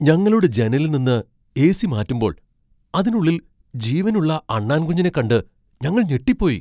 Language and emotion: Malayalam, surprised